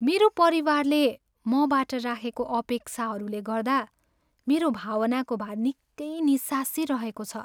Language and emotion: Nepali, sad